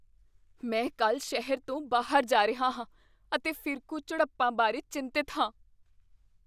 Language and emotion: Punjabi, fearful